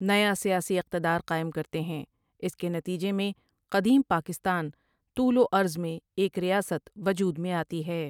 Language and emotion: Urdu, neutral